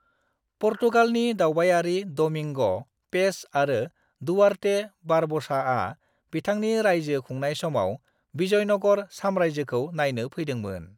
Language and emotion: Bodo, neutral